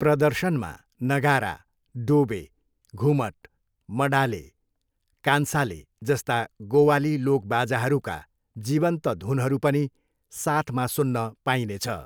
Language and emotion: Nepali, neutral